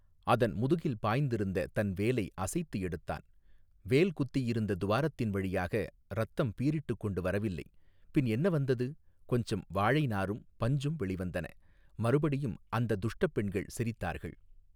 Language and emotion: Tamil, neutral